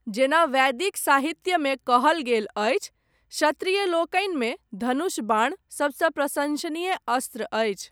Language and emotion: Maithili, neutral